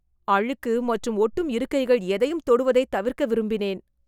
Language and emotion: Tamil, disgusted